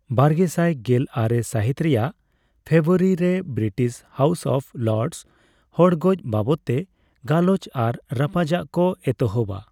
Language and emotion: Santali, neutral